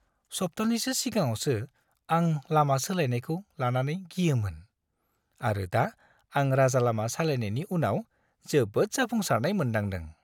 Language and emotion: Bodo, happy